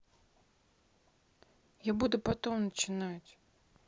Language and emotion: Russian, neutral